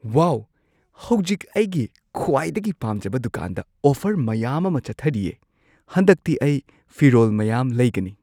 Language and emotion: Manipuri, surprised